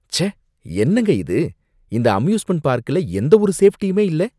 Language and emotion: Tamil, disgusted